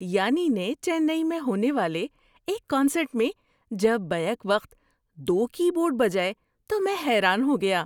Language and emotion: Urdu, surprised